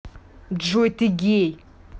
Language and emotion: Russian, angry